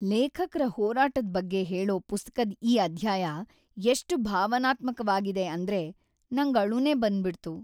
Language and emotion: Kannada, sad